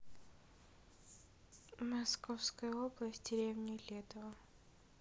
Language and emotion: Russian, neutral